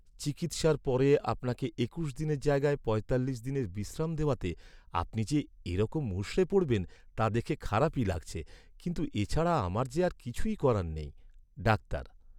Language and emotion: Bengali, sad